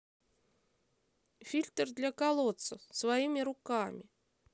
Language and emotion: Russian, neutral